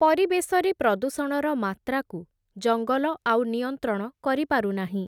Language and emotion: Odia, neutral